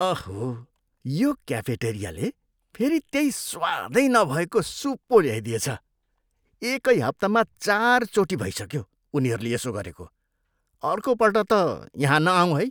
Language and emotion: Nepali, disgusted